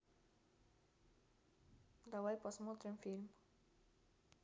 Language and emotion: Russian, neutral